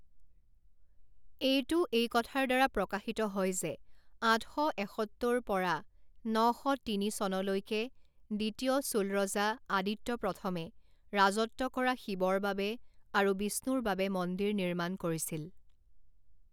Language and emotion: Assamese, neutral